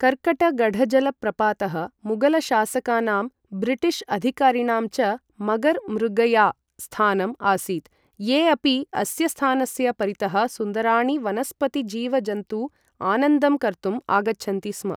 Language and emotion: Sanskrit, neutral